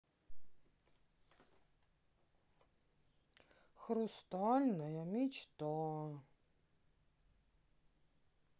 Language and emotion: Russian, sad